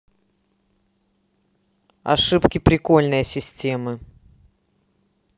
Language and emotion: Russian, neutral